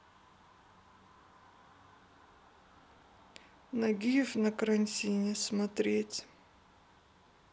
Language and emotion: Russian, sad